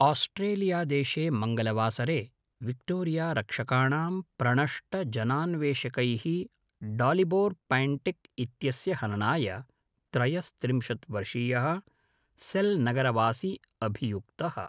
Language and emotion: Sanskrit, neutral